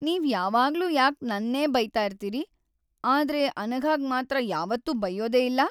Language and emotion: Kannada, sad